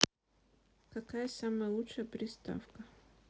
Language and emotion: Russian, neutral